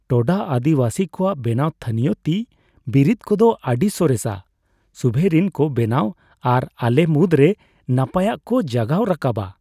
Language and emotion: Santali, happy